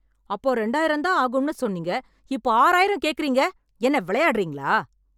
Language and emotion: Tamil, angry